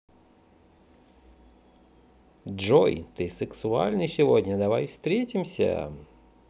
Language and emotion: Russian, positive